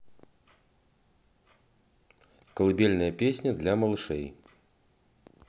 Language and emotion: Russian, neutral